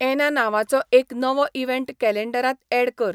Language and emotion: Goan Konkani, neutral